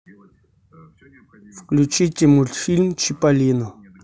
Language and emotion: Russian, neutral